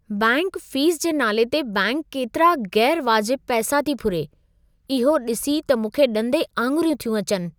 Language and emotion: Sindhi, surprised